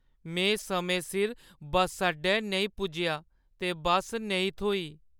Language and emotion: Dogri, sad